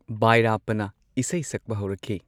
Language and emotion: Manipuri, neutral